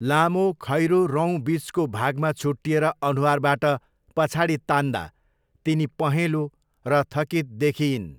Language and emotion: Nepali, neutral